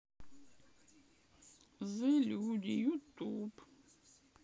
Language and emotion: Russian, sad